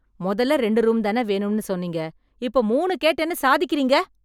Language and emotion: Tamil, angry